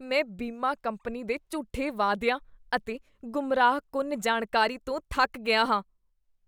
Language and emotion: Punjabi, disgusted